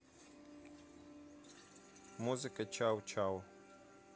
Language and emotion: Russian, neutral